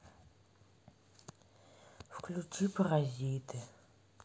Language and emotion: Russian, sad